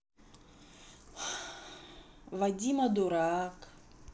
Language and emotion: Russian, neutral